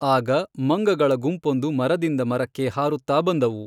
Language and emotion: Kannada, neutral